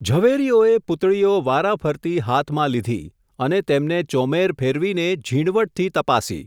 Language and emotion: Gujarati, neutral